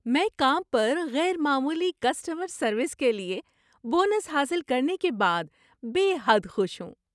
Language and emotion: Urdu, happy